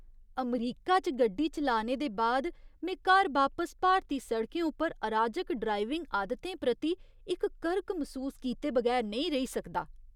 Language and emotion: Dogri, disgusted